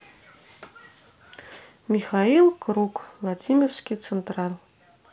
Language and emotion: Russian, neutral